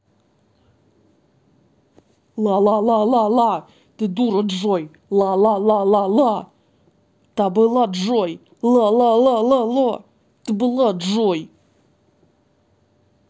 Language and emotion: Russian, angry